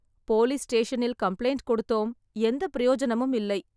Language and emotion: Tamil, sad